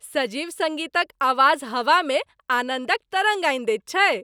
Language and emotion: Maithili, happy